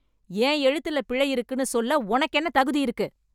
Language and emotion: Tamil, angry